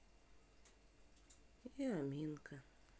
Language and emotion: Russian, sad